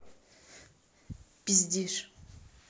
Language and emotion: Russian, angry